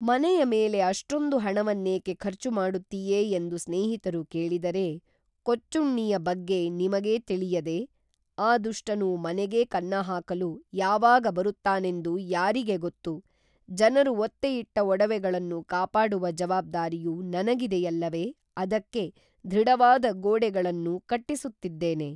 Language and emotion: Kannada, neutral